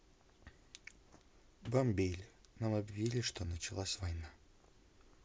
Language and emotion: Russian, sad